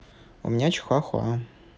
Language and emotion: Russian, neutral